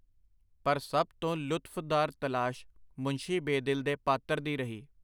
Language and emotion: Punjabi, neutral